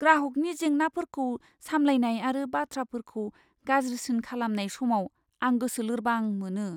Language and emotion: Bodo, fearful